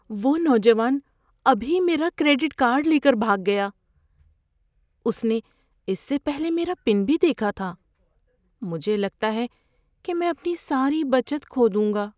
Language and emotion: Urdu, fearful